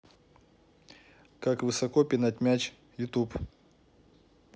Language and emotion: Russian, neutral